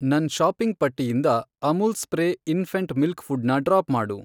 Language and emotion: Kannada, neutral